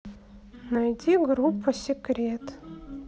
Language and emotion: Russian, neutral